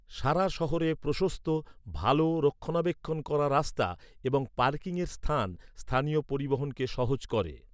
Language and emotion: Bengali, neutral